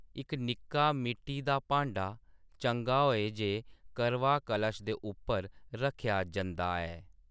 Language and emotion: Dogri, neutral